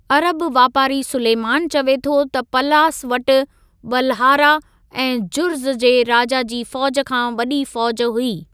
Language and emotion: Sindhi, neutral